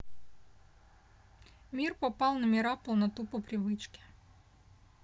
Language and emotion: Russian, neutral